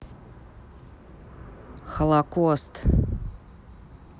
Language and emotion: Russian, neutral